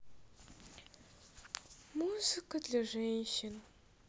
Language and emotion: Russian, sad